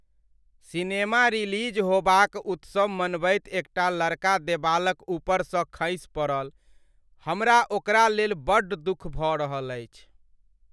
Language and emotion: Maithili, sad